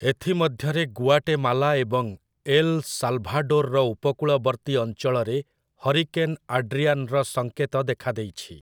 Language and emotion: Odia, neutral